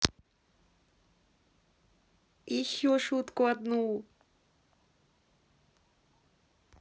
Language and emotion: Russian, neutral